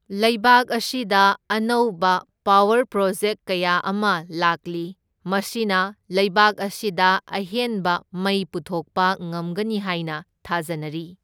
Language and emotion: Manipuri, neutral